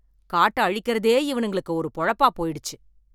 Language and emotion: Tamil, angry